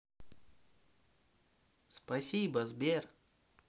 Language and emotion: Russian, positive